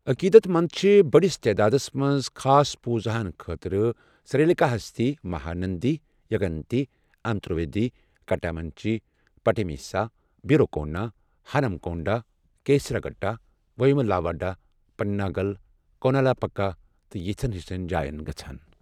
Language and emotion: Kashmiri, neutral